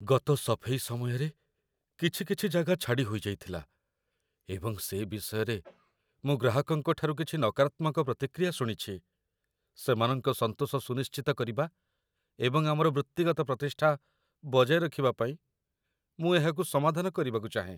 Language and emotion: Odia, fearful